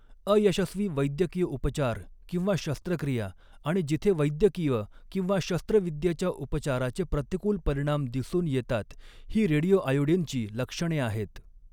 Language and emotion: Marathi, neutral